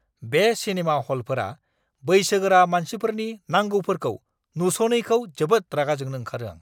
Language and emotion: Bodo, angry